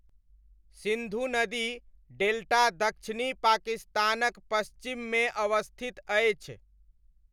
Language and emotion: Maithili, neutral